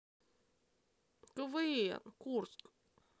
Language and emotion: Russian, neutral